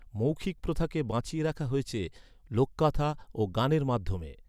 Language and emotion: Bengali, neutral